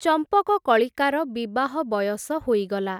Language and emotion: Odia, neutral